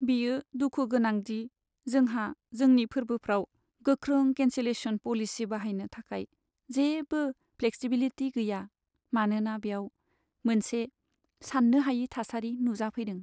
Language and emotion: Bodo, sad